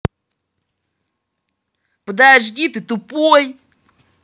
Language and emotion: Russian, angry